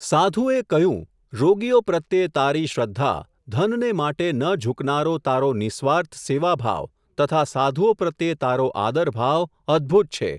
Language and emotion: Gujarati, neutral